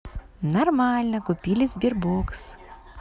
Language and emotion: Russian, positive